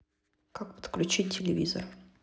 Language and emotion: Russian, neutral